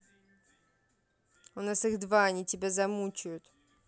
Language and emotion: Russian, angry